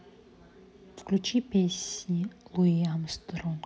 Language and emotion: Russian, neutral